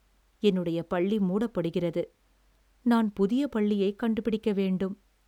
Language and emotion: Tamil, sad